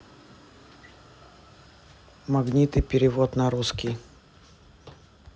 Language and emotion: Russian, neutral